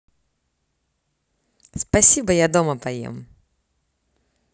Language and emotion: Russian, positive